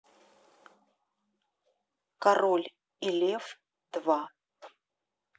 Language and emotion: Russian, neutral